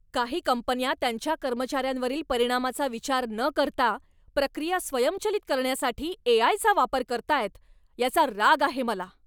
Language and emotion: Marathi, angry